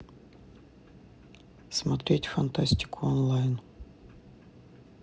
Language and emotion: Russian, neutral